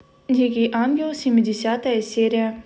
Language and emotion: Russian, neutral